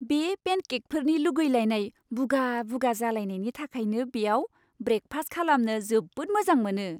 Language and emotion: Bodo, happy